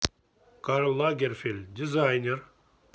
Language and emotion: Russian, neutral